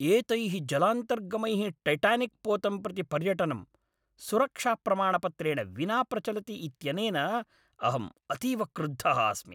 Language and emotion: Sanskrit, angry